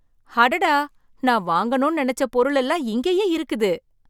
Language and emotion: Tamil, surprised